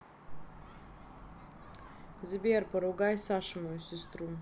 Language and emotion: Russian, neutral